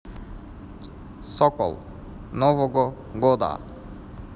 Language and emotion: Russian, neutral